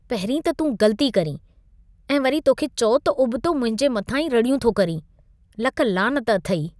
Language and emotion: Sindhi, disgusted